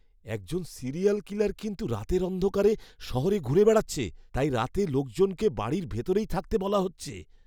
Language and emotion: Bengali, fearful